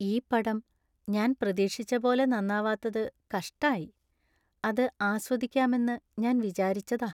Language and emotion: Malayalam, sad